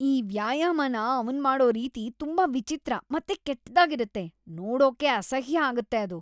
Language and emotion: Kannada, disgusted